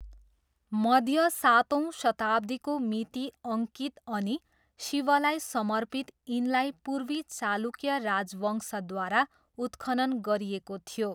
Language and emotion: Nepali, neutral